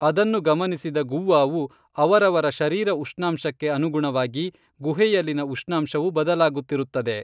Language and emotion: Kannada, neutral